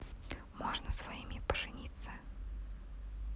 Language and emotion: Russian, neutral